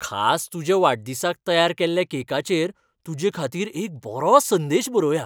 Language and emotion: Goan Konkani, happy